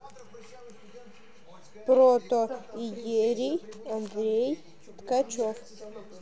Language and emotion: Russian, neutral